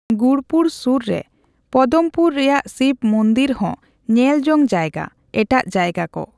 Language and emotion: Santali, neutral